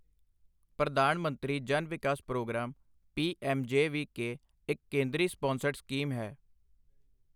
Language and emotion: Punjabi, neutral